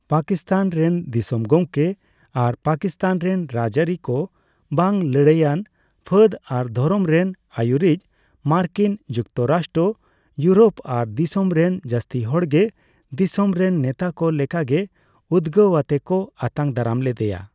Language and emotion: Santali, neutral